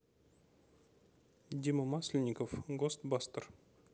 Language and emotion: Russian, neutral